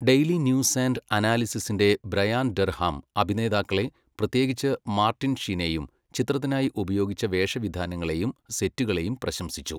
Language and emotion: Malayalam, neutral